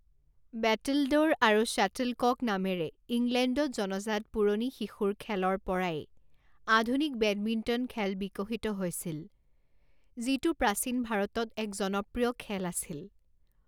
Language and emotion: Assamese, neutral